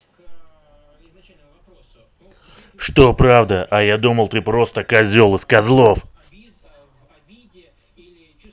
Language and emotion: Russian, angry